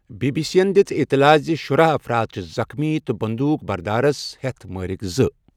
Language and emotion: Kashmiri, neutral